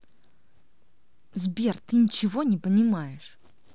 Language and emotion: Russian, angry